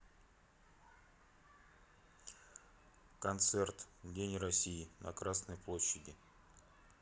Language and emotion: Russian, neutral